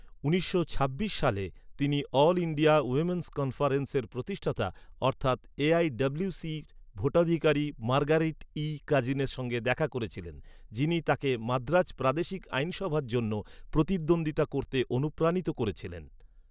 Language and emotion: Bengali, neutral